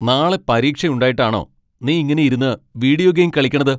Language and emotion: Malayalam, angry